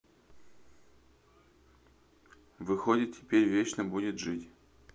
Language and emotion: Russian, neutral